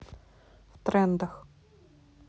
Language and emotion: Russian, neutral